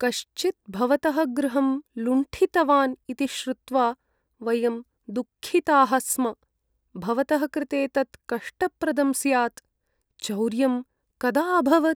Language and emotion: Sanskrit, sad